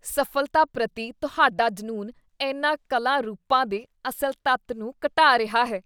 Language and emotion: Punjabi, disgusted